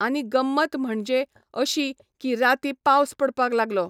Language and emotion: Goan Konkani, neutral